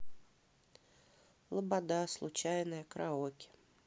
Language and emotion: Russian, neutral